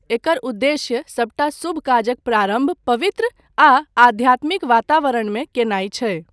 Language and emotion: Maithili, neutral